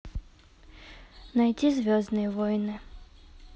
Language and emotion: Russian, neutral